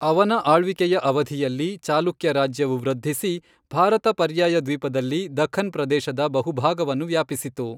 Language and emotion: Kannada, neutral